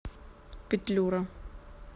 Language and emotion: Russian, neutral